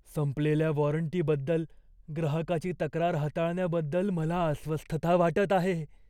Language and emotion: Marathi, fearful